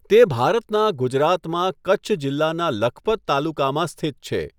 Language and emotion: Gujarati, neutral